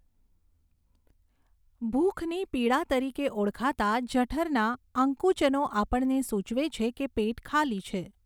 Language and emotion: Gujarati, neutral